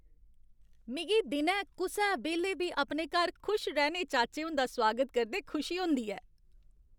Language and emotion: Dogri, happy